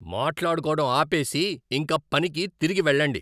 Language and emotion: Telugu, angry